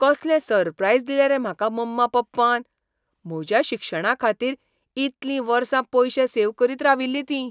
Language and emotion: Goan Konkani, surprised